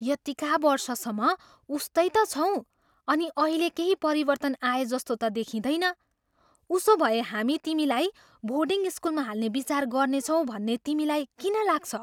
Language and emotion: Nepali, surprised